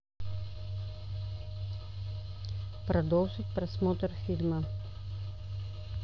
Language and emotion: Russian, neutral